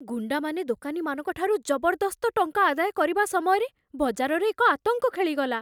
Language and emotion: Odia, fearful